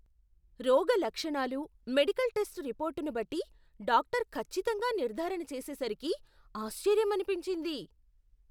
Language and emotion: Telugu, surprised